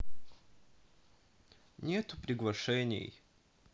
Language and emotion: Russian, sad